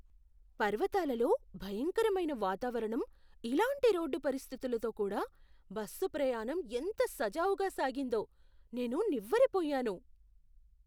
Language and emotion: Telugu, surprised